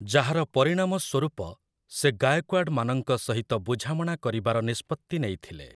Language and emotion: Odia, neutral